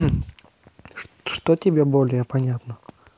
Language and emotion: Russian, neutral